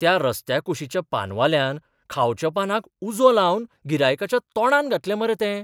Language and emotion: Goan Konkani, surprised